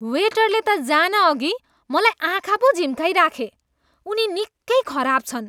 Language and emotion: Nepali, disgusted